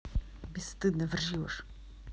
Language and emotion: Russian, neutral